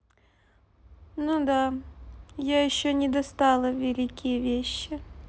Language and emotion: Russian, sad